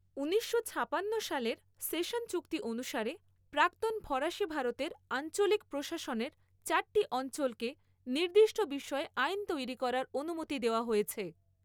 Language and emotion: Bengali, neutral